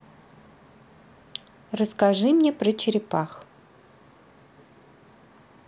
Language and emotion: Russian, neutral